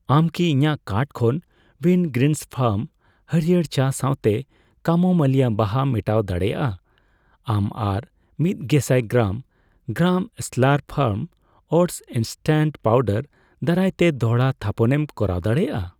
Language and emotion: Santali, neutral